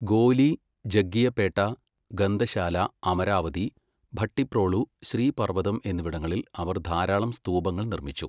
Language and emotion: Malayalam, neutral